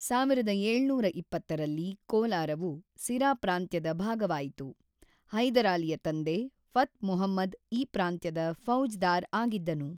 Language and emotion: Kannada, neutral